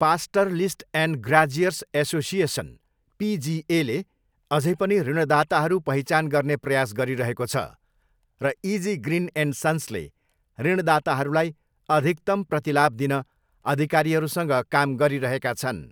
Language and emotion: Nepali, neutral